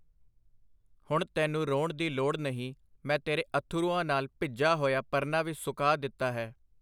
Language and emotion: Punjabi, neutral